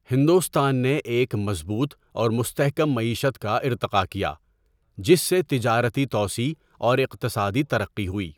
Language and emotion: Urdu, neutral